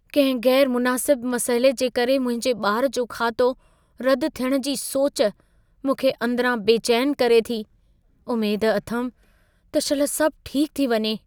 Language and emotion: Sindhi, fearful